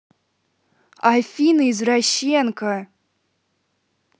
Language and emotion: Russian, angry